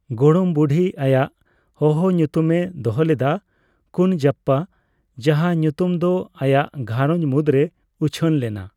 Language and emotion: Santali, neutral